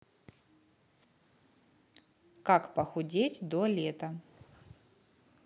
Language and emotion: Russian, neutral